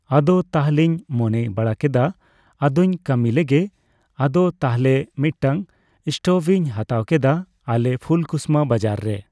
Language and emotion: Santali, neutral